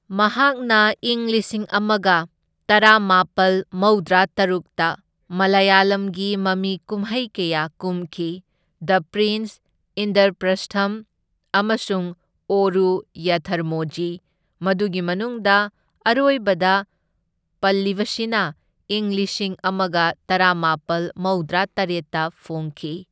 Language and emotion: Manipuri, neutral